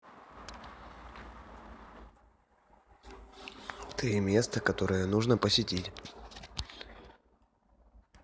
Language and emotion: Russian, neutral